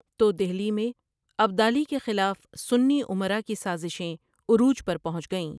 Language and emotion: Urdu, neutral